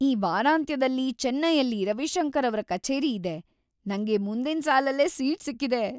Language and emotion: Kannada, happy